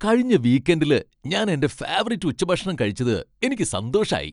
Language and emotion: Malayalam, happy